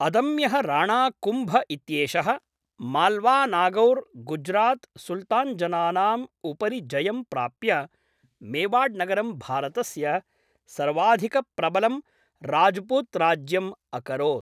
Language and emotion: Sanskrit, neutral